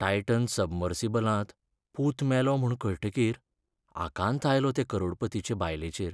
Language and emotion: Goan Konkani, sad